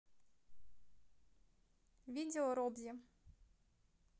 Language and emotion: Russian, neutral